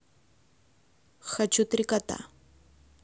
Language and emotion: Russian, neutral